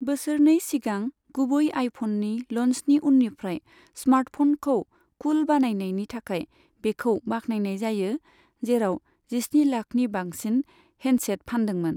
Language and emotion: Bodo, neutral